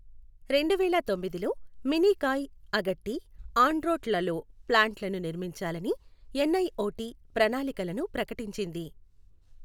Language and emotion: Telugu, neutral